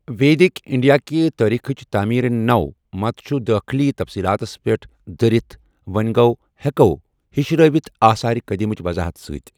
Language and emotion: Kashmiri, neutral